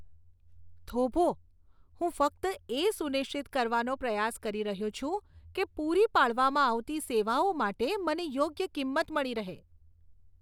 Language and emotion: Gujarati, disgusted